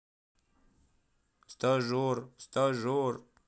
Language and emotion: Russian, sad